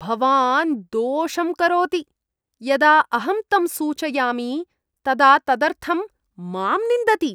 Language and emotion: Sanskrit, disgusted